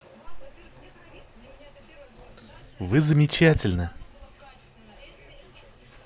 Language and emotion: Russian, positive